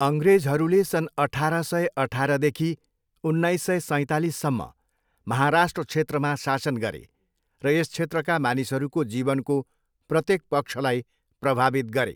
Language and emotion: Nepali, neutral